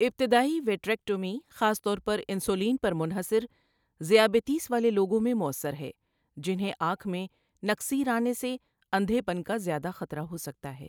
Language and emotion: Urdu, neutral